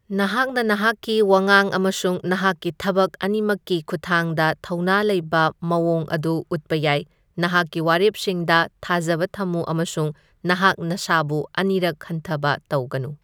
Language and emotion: Manipuri, neutral